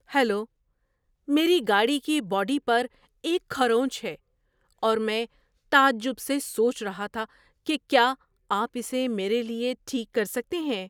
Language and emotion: Urdu, surprised